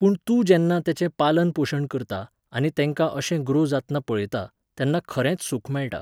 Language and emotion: Goan Konkani, neutral